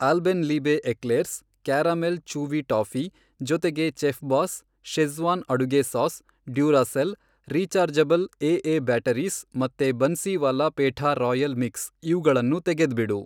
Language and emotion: Kannada, neutral